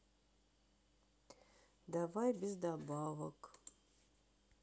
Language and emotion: Russian, sad